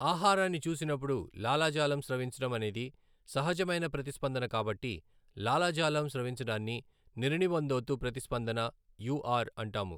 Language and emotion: Telugu, neutral